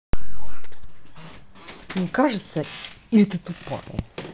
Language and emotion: Russian, angry